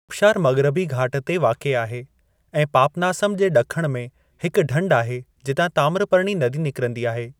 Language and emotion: Sindhi, neutral